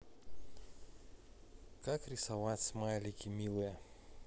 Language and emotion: Russian, neutral